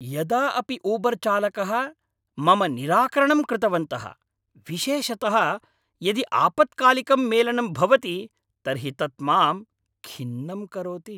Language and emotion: Sanskrit, angry